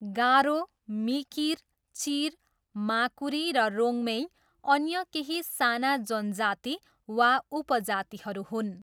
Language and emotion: Nepali, neutral